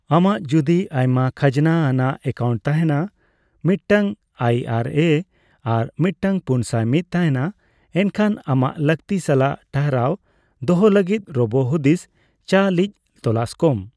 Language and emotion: Santali, neutral